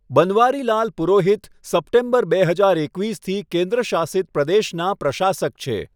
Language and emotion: Gujarati, neutral